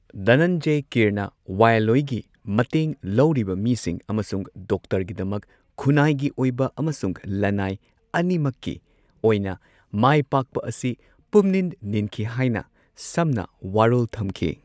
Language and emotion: Manipuri, neutral